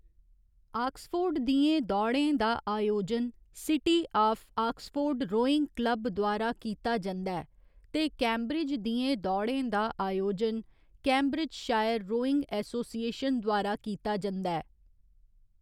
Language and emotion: Dogri, neutral